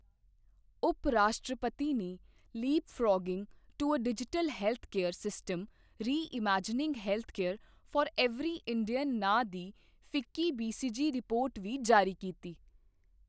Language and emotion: Punjabi, neutral